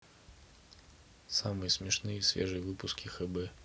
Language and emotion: Russian, neutral